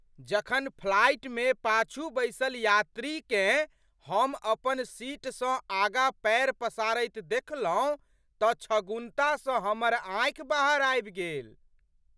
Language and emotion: Maithili, surprised